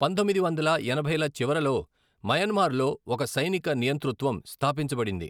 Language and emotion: Telugu, neutral